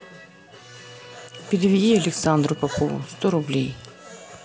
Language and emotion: Russian, neutral